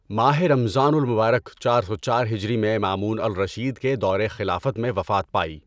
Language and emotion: Urdu, neutral